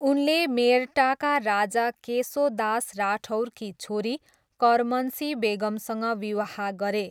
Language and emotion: Nepali, neutral